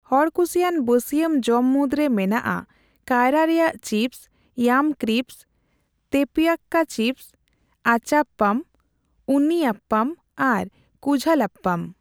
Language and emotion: Santali, neutral